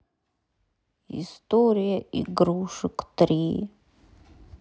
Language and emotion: Russian, sad